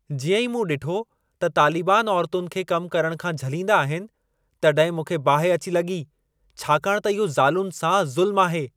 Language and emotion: Sindhi, angry